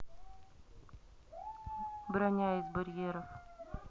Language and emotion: Russian, neutral